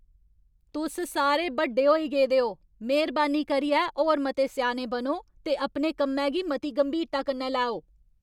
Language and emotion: Dogri, angry